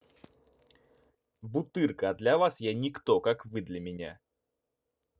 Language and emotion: Russian, neutral